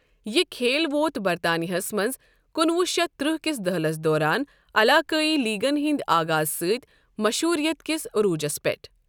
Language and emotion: Kashmiri, neutral